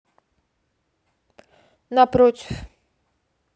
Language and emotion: Russian, neutral